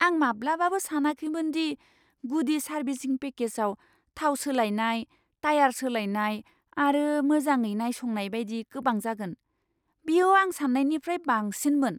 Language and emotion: Bodo, surprised